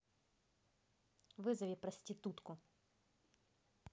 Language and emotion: Russian, angry